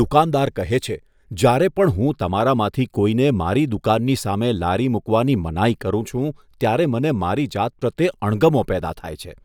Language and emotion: Gujarati, disgusted